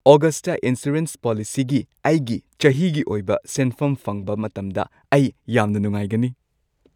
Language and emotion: Manipuri, happy